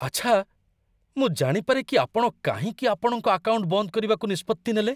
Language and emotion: Odia, surprised